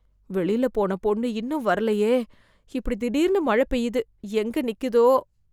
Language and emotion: Tamil, fearful